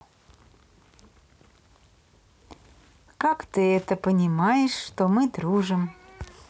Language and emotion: Russian, neutral